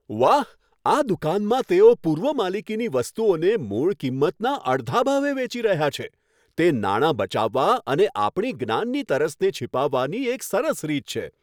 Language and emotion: Gujarati, happy